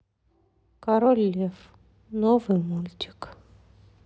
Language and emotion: Russian, sad